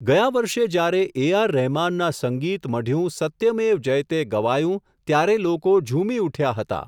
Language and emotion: Gujarati, neutral